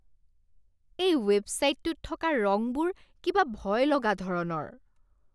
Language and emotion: Assamese, disgusted